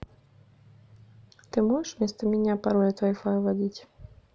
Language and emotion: Russian, neutral